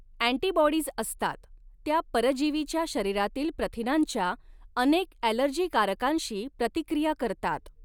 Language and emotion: Marathi, neutral